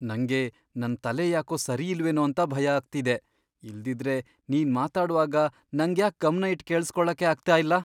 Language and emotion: Kannada, fearful